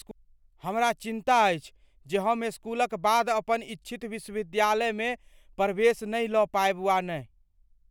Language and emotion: Maithili, fearful